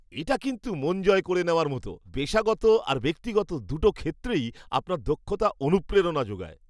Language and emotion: Bengali, happy